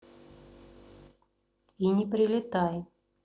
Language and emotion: Russian, neutral